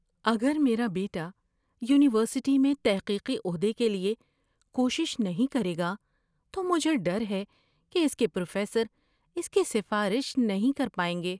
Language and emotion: Urdu, fearful